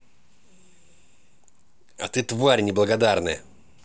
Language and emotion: Russian, angry